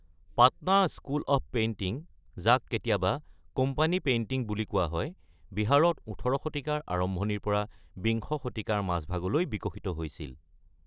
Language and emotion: Assamese, neutral